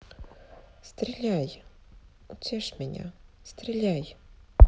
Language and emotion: Russian, sad